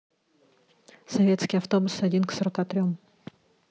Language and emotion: Russian, neutral